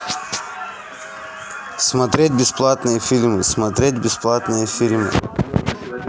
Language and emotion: Russian, neutral